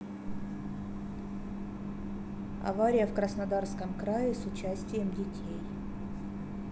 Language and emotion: Russian, neutral